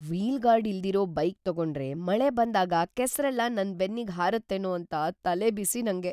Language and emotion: Kannada, fearful